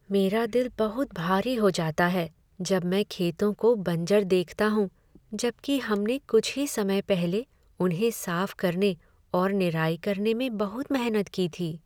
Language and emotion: Hindi, sad